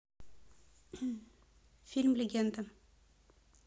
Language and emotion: Russian, neutral